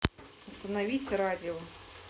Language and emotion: Russian, neutral